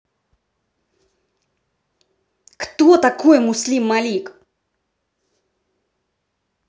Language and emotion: Russian, angry